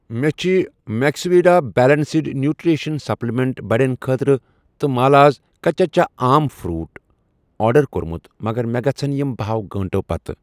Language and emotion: Kashmiri, neutral